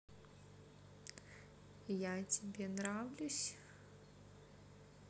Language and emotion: Russian, positive